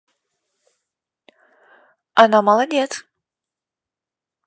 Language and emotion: Russian, positive